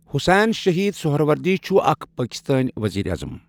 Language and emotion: Kashmiri, neutral